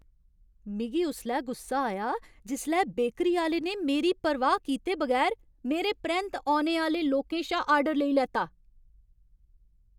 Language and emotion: Dogri, angry